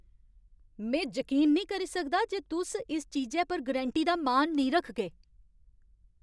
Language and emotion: Dogri, angry